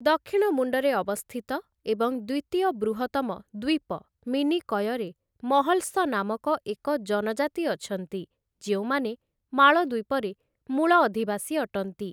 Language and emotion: Odia, neutral